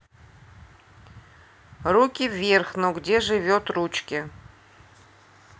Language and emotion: Russian, neutral